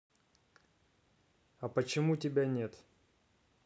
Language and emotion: Russian, neutral